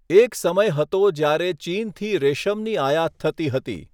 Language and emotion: Gujarati, neutral